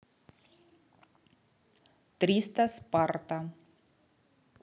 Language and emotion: Russian, neutral